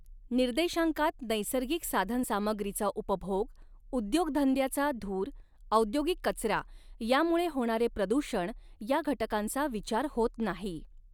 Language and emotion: Marathi, neutral